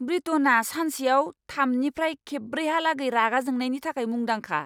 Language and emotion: Bodo, angry